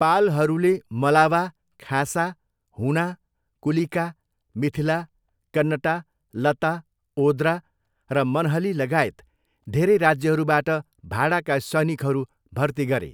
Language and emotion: Nepali, neutral